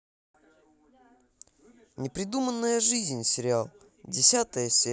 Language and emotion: Russian, positive